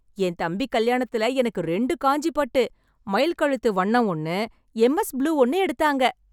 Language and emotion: Tamil, happy